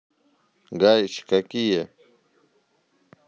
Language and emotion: Russian, neutral